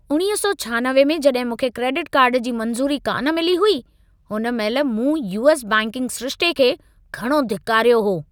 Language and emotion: Sindhi, angry